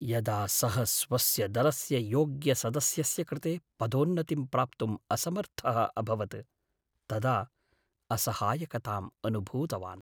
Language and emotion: Sanskrit, sad